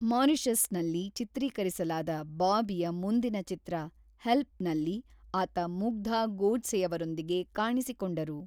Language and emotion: Kannada, neutral